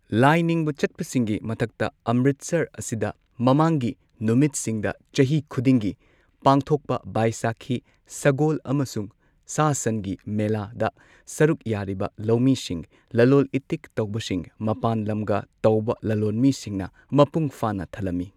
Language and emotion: Manipuri, neutral